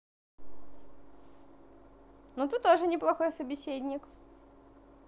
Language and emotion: Russian, positive